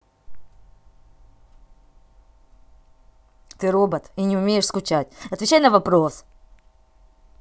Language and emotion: Russian, angry